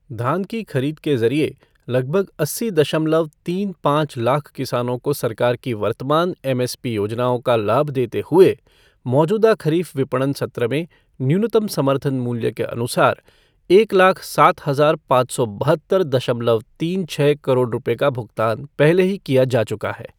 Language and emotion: Hindi, neutral